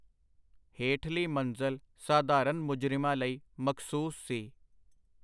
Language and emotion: Punjabi, neutral